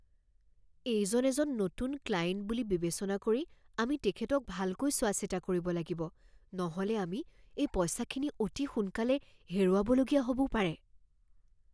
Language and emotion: Assamese, fearful